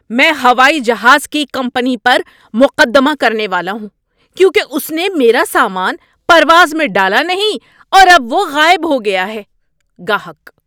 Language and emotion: Urdu, angry